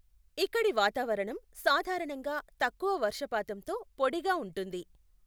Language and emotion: Telugu, neutral